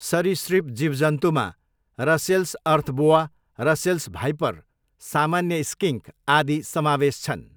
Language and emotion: Nepali, neutral